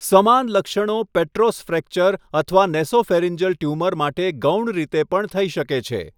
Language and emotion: Gujarati, neutral